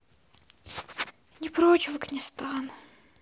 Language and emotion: Russian, sad